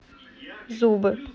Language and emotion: Russian, neutral